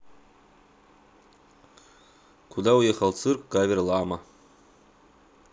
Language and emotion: Russian, neutral